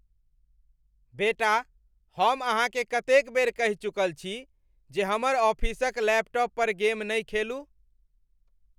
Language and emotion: Maithili, angry